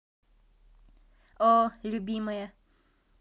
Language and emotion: Russian, positive